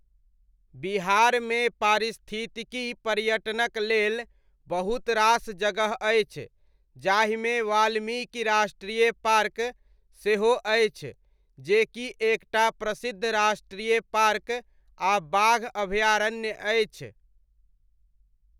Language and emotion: Maithili, neutral